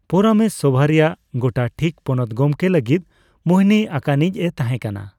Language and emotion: Santali, neutral